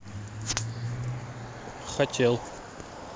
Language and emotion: Russian, neutral